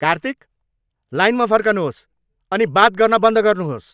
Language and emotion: Nepali, angry